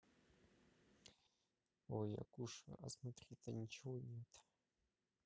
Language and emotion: Russian, neutral